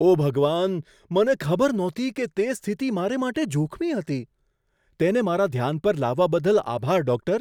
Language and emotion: Gujarati, surprised